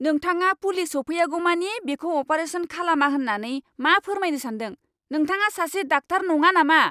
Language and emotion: Bodo, angry